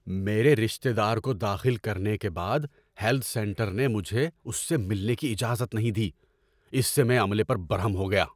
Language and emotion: Urdu, angry